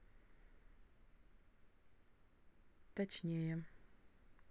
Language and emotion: Russian, neutral